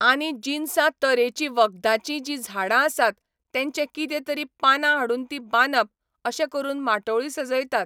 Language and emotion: Goan Konkani, neutral